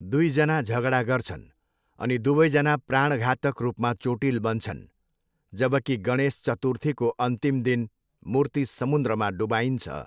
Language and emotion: Nepali, neutral